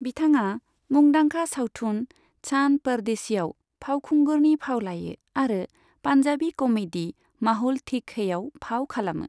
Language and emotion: Bodo, neutral